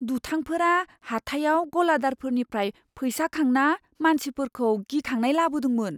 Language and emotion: Bodo, fearful